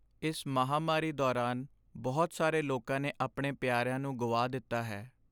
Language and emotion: Punjabi, sad